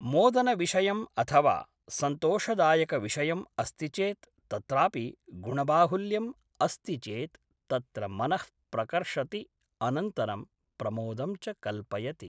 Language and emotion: Sanskrit, neutral